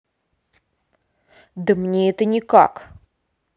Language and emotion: Russian, angry